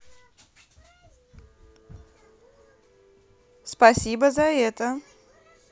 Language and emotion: Russian, positive